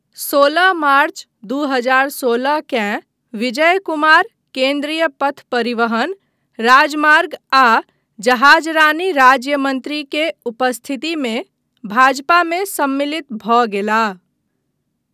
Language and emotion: Maithili, neutral